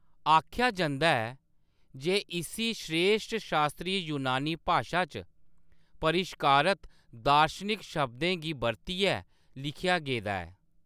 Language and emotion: Dogri, neutral